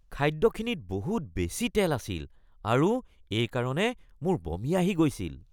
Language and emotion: Assamese, disgusted